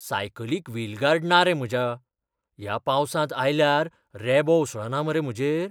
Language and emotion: Goan Konkani, fearful